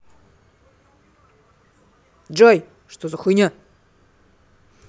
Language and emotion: Russian, angry